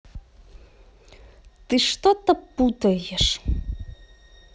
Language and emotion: Russian, angry